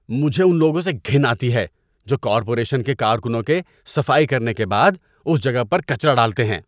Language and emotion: Urdu, disgusted